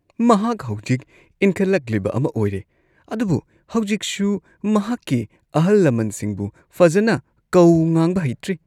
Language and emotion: Manipuri, disgusted